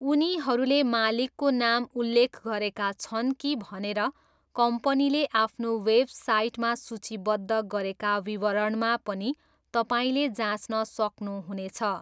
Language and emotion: Nepali, neutral